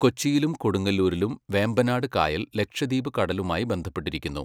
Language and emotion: Malayalam, neutral